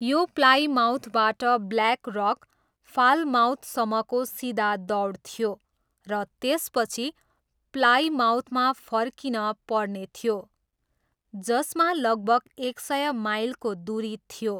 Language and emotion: Nepali, neutral